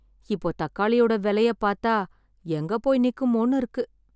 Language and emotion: Tamil, sad